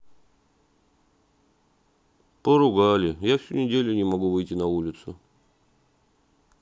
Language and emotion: Russian, sad